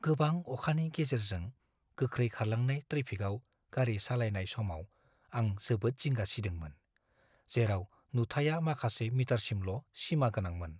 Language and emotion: Bodo, fearful